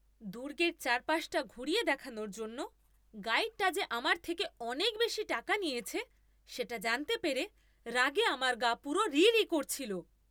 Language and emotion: Bengali, angry